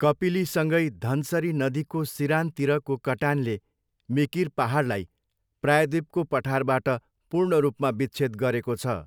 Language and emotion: Nepali, neutral